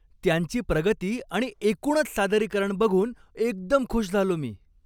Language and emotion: Marathi, happy